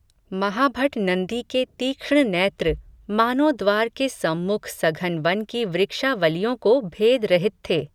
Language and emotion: Hindi, neutral